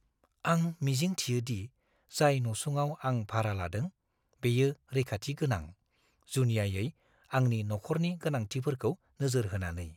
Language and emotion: Bodo, fearful